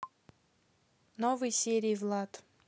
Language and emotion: Russian, neutral